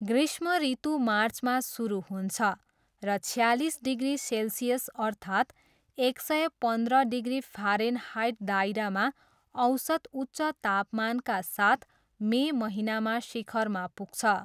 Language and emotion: Nepali, neutral